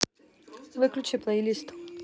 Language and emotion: Russian, neutral